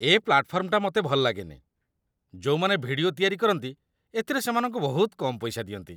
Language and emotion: Odia, disgusted